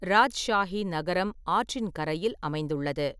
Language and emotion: Tamil, neutral